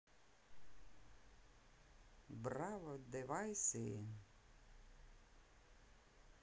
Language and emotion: Russian, positive